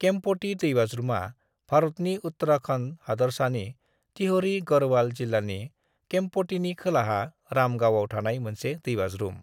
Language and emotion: Bodo, neutral